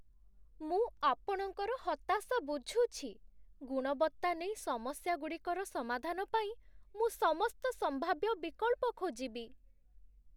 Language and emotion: Odia, sad